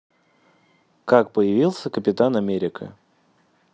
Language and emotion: Russian, neutral